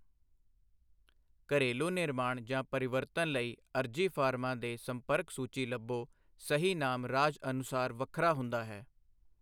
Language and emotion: Punjabi, neutral